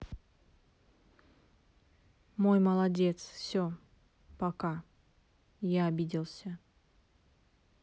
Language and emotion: Russian, sad